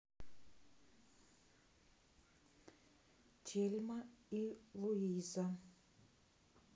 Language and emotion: Russian, neutral